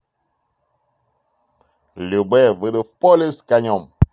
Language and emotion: Russian, positive